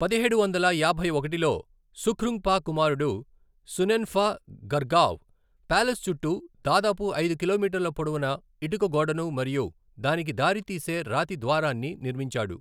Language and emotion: Telugu, neutral